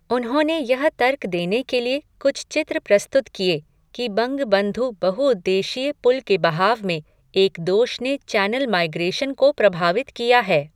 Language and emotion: Hindi, neutral